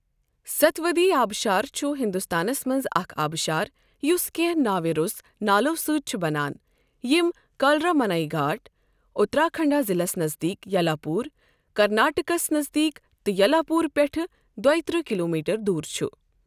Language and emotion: Kashmiri, neutral